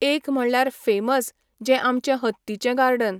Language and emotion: Goan Konkani, neutral